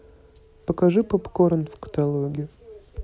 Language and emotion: Russian, neutral